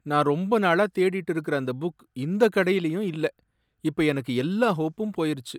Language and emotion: Tamil, sad